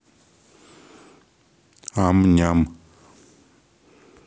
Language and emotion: Russian, neutral